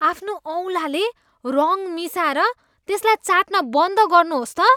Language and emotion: Nepali, disgusted